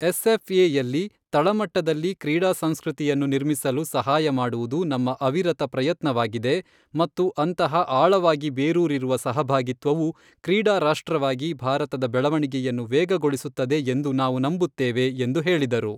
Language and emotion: Kannada, neutral